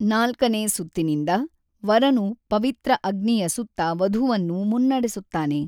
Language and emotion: Kannada, neutral